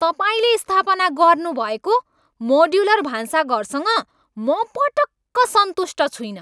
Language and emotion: Nepali, angry